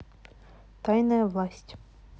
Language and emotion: Russian, neutral